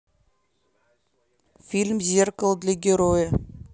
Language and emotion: Russian, neutral